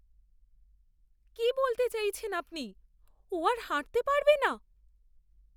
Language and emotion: Bengali, fearful